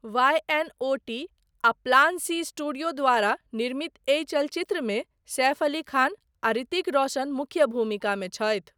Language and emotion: Maithili, neutral